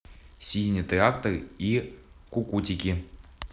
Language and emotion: Russian, neutral